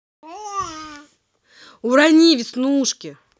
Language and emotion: Russian, angry